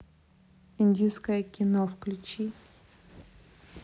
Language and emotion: Russian, neutral